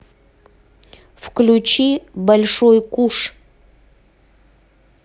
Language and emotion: Russian, neutral